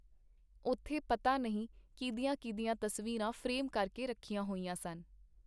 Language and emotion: Punjabi, neutral